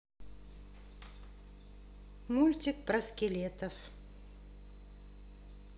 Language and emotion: Russian, neutral